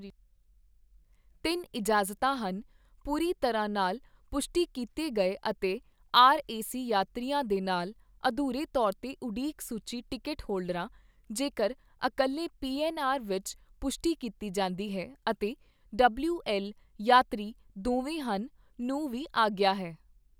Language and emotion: Punjabi, neutral